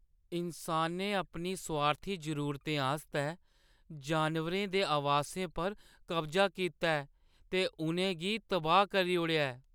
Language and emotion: Dogri, sad